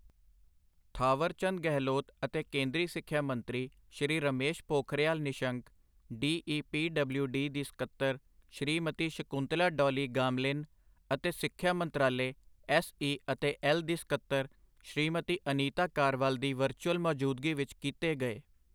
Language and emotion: Punjabi, neutral